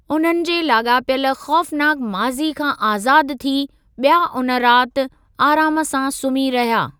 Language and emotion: Sindhi, neutral